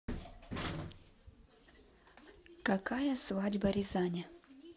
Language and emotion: Russian, neutral